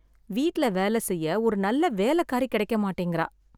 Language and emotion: Tamil, sad